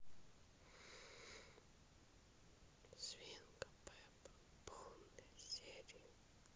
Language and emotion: Russian, neutral